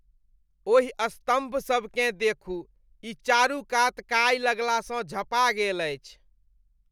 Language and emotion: Maithili, disgusted